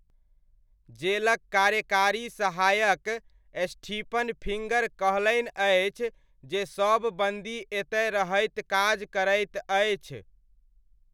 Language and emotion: Maithili, neutral